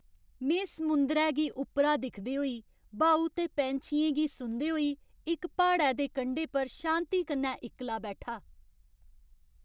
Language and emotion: Dogri, happy